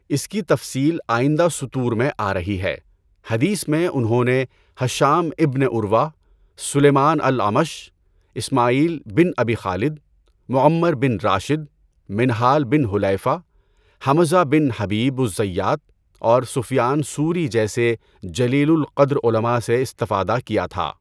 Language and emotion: Urdu, neutral